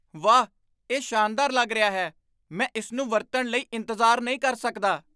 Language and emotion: Punjabi, surprised